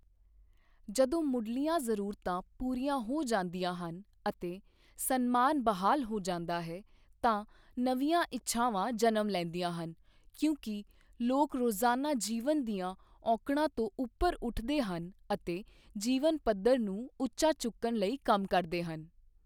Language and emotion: Punjabi, neutral